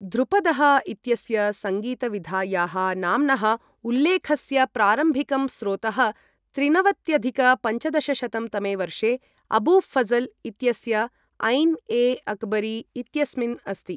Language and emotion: Sanskrit, neutral